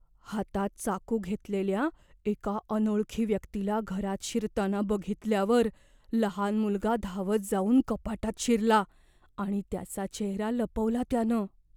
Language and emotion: Marathi, fearful